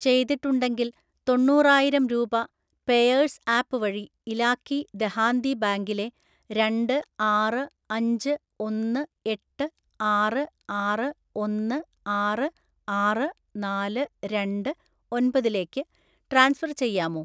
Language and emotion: Malayalam, neutral